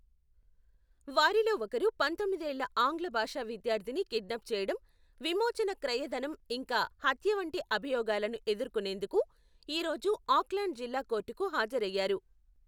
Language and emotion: Telugu, neutral